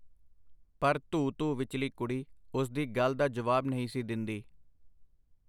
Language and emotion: Punjabi, neutral